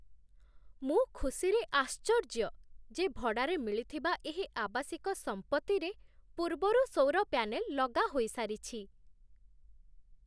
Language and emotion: Odia, surprised